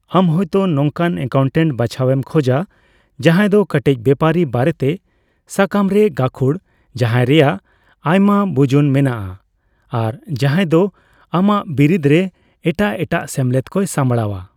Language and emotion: Santali, neutral